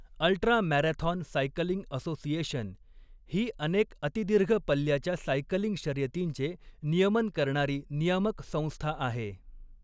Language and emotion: Marathi, neutral